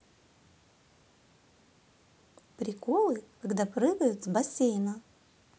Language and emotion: Russian, neutral